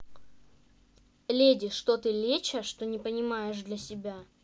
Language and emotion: Russian, neutral